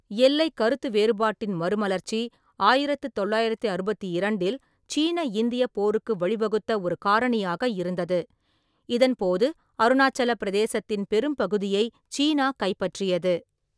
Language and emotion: Tamil, neutral